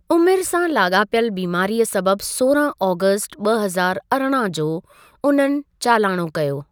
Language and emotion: Sindhi, neutral